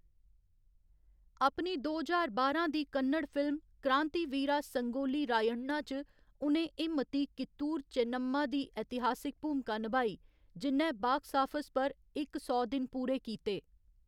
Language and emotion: Dogri, neutral